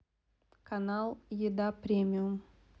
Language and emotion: Russian, neutral